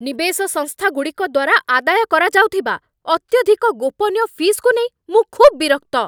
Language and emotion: Odia, angry